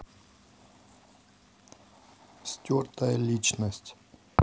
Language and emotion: Russian, neutral